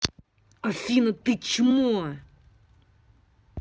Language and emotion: Russian, angry